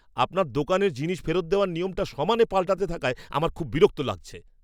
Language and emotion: Bengali, angry